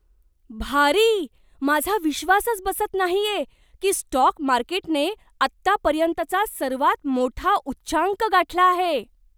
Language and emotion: Marathi, surprised